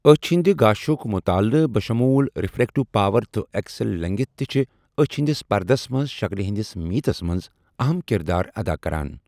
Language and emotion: Kashmiri, neutral